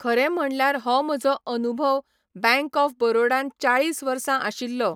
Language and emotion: Goan Konkani, neutral